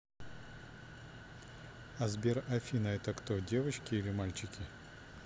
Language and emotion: Russian, neutral